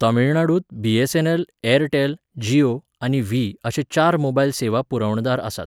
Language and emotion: Goan Konkani, neutral